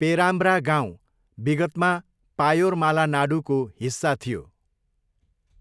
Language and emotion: Nepali, neutral